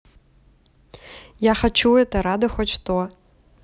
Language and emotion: Russian, neutral